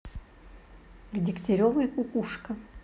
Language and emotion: Russian, neutral